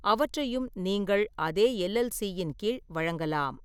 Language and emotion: Tamil, neutral